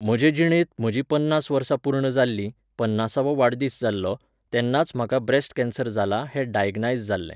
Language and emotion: Goan Konkani, neutral